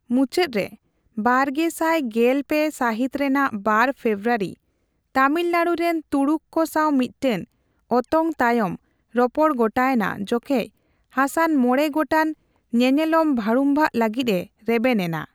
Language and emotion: Santali, neutral